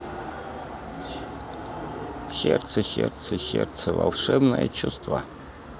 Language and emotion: Russian, neutral